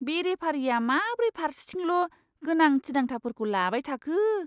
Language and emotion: Bodo, disgusted